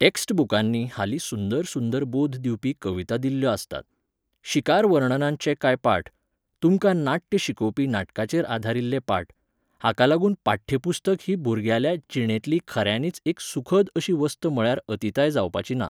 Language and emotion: Goan Konkani, neutral